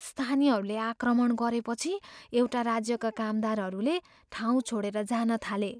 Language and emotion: Nepali, fearful